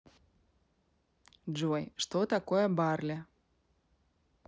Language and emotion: Russian, neutral